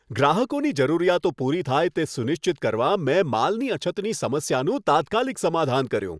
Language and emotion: Gujarati, happy